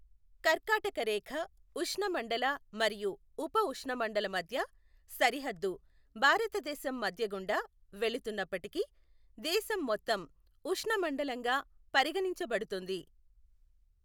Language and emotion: Telugu, neutral